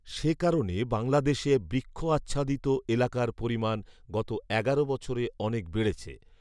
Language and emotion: Bengali, neutral